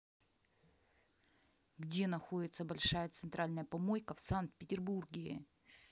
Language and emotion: Russian, angry